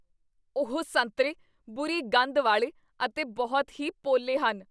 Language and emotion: Punjabi, disgusted